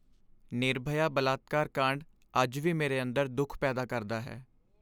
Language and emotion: Punjabi, sad